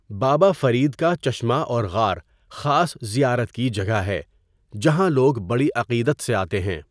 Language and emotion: Urdu, neutral